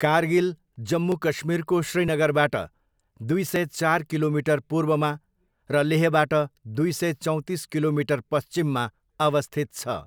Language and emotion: Nepali, neutral